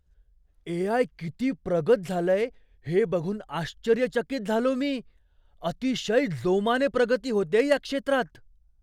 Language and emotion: Marathi, surprised